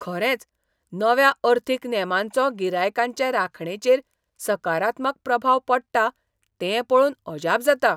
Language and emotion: Goan Konkani, surprised